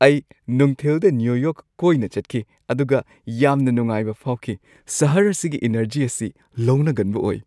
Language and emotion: Manipuri, happy